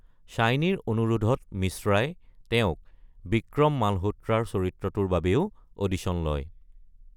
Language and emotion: Assamese, neutral